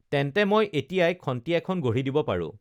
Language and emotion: Assamese, neutral